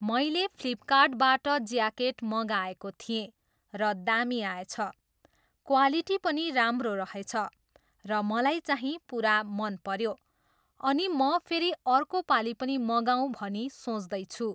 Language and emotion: Nepali, neutral